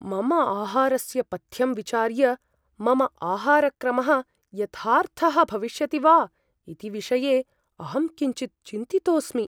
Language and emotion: Sanskrit, fearful